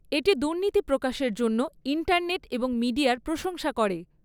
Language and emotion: Bengali, neutral